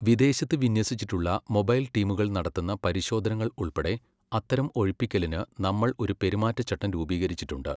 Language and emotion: Malayalam, neutral